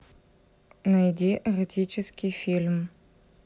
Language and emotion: Russian, neutral